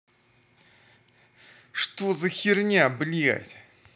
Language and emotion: Russian, angry